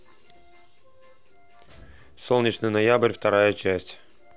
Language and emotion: Russian, neutral